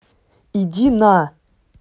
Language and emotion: Russian, angry